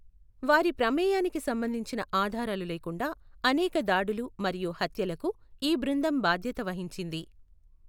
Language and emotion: Telugu, neutral